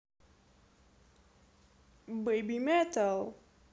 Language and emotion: Russian, positive